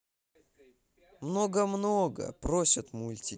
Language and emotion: Russian, neutral